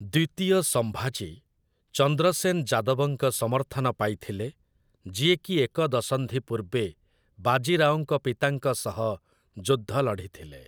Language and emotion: Odia, neutral